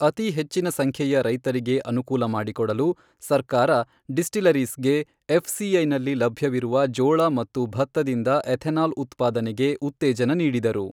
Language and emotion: Kannada, neutral